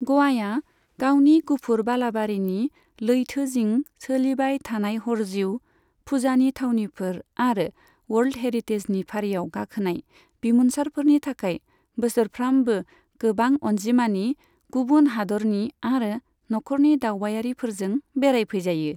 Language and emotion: Bodo, neutral